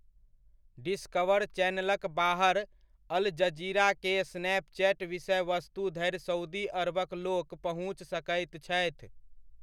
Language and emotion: Maithili, neutral